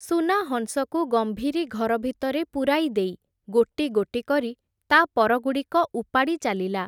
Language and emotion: Odia, neutral